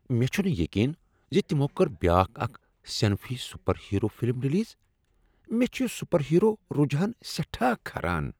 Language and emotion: Kashmiri, disgusted